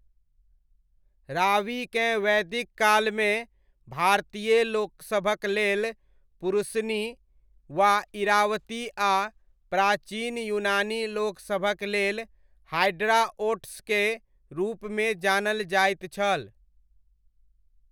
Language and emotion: Maithili, neutral